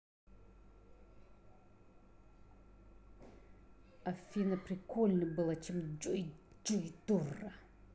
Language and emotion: Russian, angry